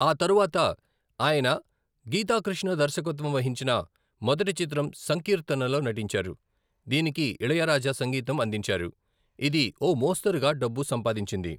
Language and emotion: Telugu, neutral